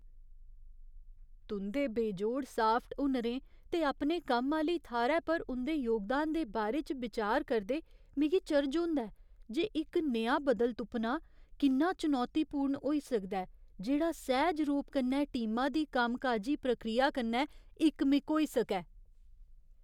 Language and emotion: Dogri, fearful